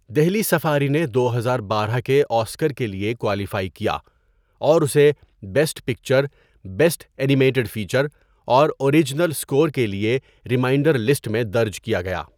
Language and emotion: Urdu, neutral